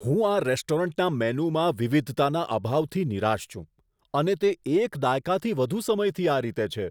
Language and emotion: Gujarati, disgusted